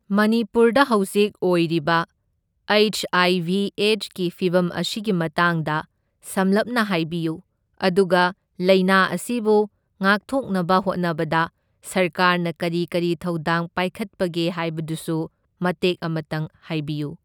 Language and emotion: Manipuri, neutral